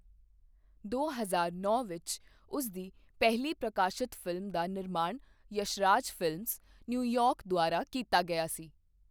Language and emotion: Punjabi, neutral